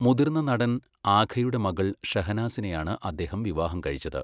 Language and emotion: Malayalam, neutral